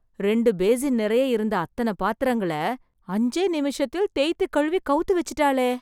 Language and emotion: Tamil, surprised